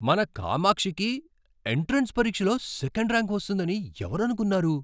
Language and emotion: Telugu, surprised